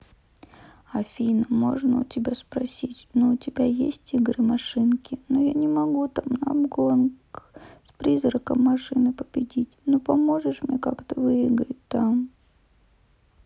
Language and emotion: Russian, sad